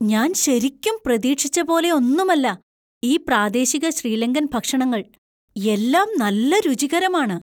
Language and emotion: Malayalam, surprised